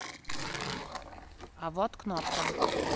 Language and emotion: Russian, neutral